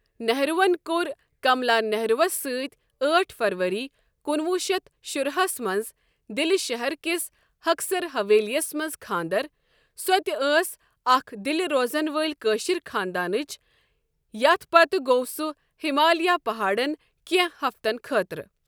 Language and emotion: Kashmiri, neutral